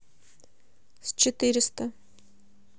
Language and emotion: Russian, neutral